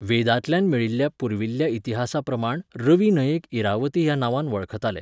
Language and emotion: Goan Konkani, neutral